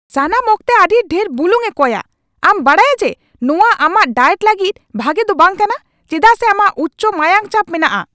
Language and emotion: Santali, angry